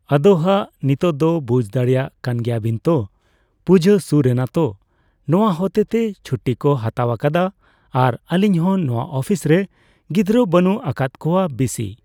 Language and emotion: Santali, neutral